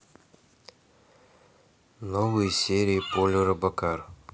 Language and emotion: Russian, neutral